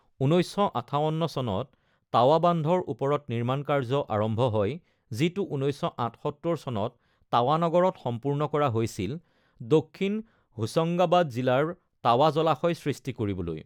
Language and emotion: Assamese, neutral